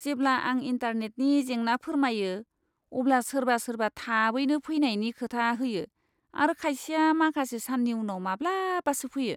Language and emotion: Bodo, disgusted